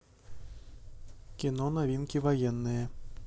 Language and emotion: Russian, neutral